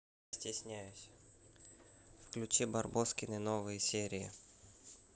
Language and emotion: Russian, neutral